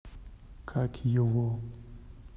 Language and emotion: Russian, neutral